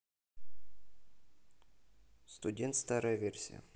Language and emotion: Russian, neutral